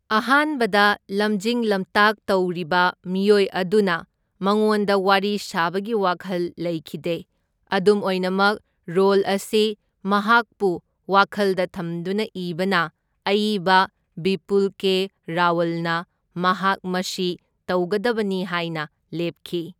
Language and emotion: Manipuri, neutral